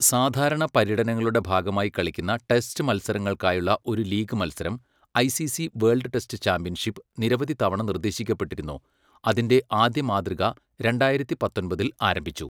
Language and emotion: Malayalam, neutral